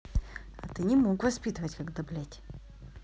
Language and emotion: Russian, neutral